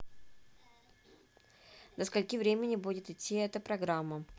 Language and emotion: Russian, neutral